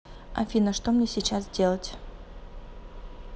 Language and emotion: Russian, neutral